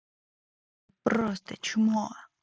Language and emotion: Russian, angry